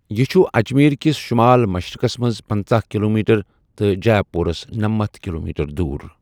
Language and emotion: Kashmiri, neutral